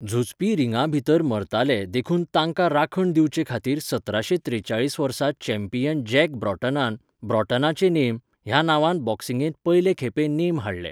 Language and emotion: Goan Konkani, neutral